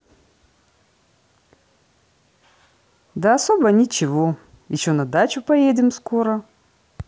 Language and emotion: Russian, positive